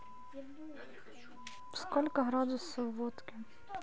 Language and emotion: Russian, neutral